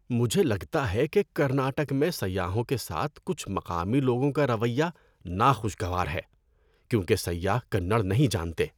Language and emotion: Urdu, disgusted